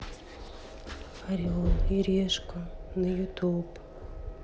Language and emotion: Russian, sad